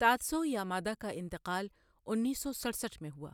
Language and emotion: Urdu, neutral